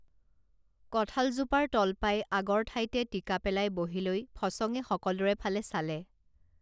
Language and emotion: Assamese, neutral